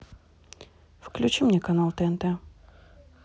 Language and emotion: Russian, neutral